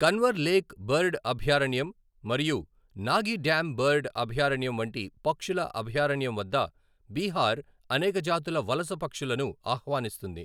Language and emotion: Telugu, neutral